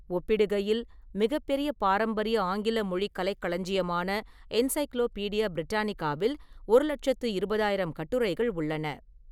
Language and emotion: Tamil, neutral